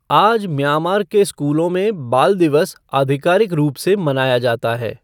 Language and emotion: Hindi, neutral